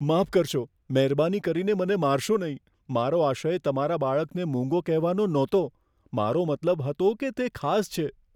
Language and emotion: Gujarati, fearful